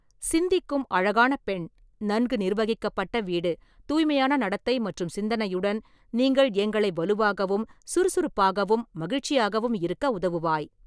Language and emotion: Tamil, neutral